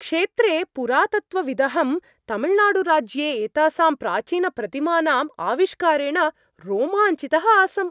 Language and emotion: Sanskrit, happy